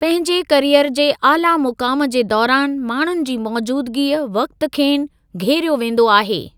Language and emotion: Sindhi, neutral